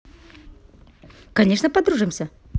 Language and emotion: Russian, positive